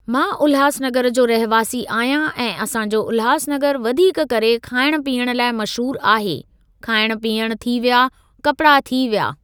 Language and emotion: Sindhi, neutral